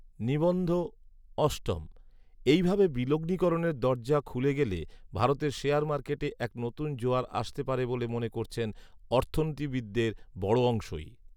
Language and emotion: Bengali, neutral